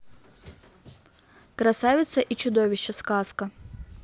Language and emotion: Russian, neutral